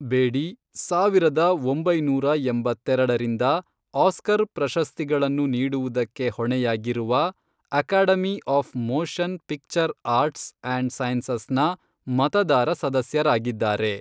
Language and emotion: Kannada, neutral